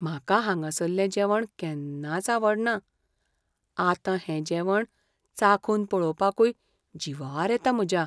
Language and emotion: Goan Konkani, fearful